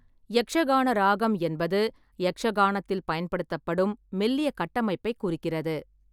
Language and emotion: Tamil, neutral